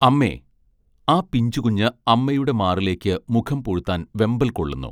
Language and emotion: Malayalam, neutral